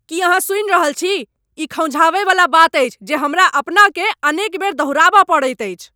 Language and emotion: Maithili, angry